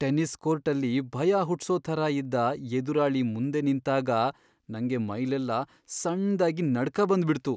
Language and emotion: Kannada, fearful